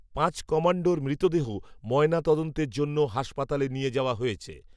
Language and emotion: Bengali, neutral